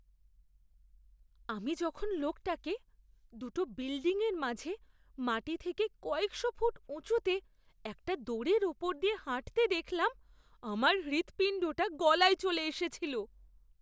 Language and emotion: Bengali, fearful